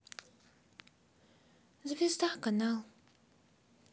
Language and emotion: Russian, sad